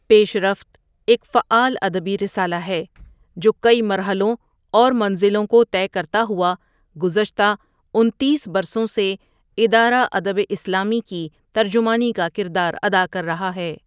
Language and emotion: Urdu, neutral